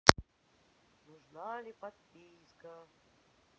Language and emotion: Russian, sad